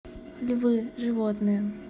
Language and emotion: Russian, neutral